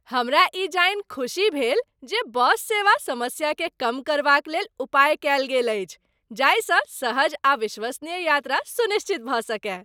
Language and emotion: Maithili, happy